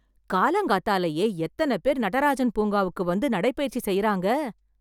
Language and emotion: Tamil, surprised